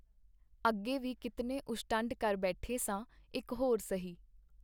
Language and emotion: Punjabi, neutral